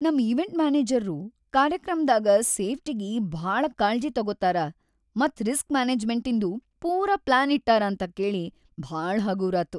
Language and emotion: Kannada, happy